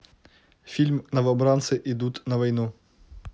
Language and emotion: Russian, neutral